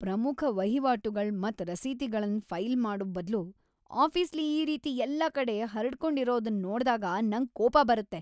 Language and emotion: Kannada, angry